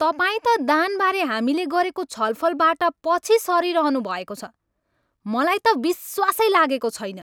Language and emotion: Nepali, angry